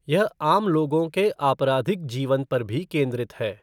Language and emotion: Hindi, neutral